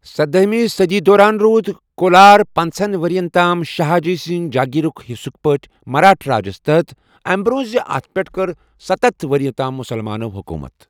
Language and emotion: Kashmiri, neutral